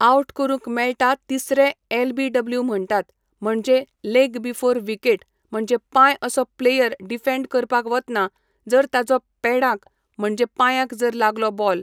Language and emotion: Goan Konkani, neutral